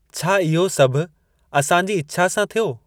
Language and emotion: Sindhi, neutral